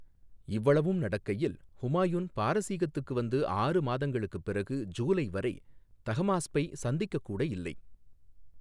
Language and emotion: Tamil, neutral